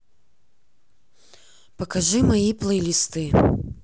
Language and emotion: Russian, neutral